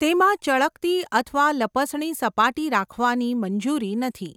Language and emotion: Gujarati, neutral